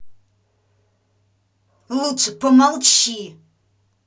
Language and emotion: Russian, angry